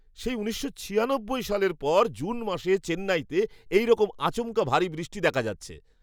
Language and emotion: Bengali, surprised